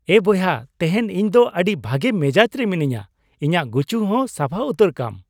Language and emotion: Santali, happy